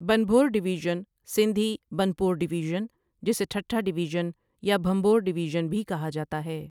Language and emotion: Urdu, neutral